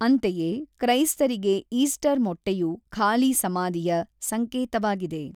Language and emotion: Kannada, neutral